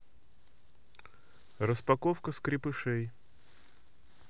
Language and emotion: Russian, neutral